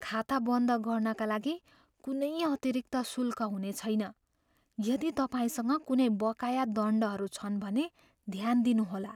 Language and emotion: Nepali, fearful